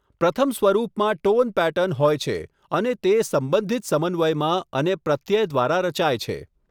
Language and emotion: Gujarati, neutral